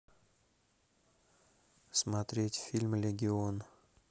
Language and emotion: Russian, neutral